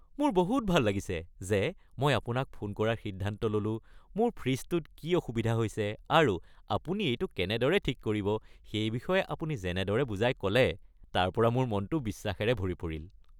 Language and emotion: Assamese, happy